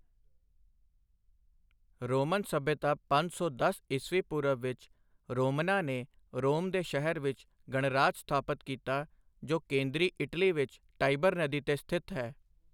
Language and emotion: Punjabi, neutral